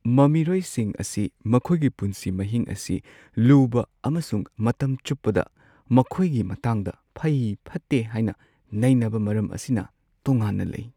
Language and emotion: Manipuri, sad